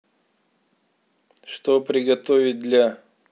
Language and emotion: Russian, neutral